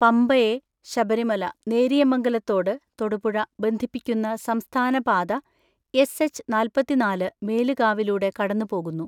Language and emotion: Malayalam, neutral